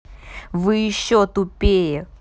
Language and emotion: Russian, angry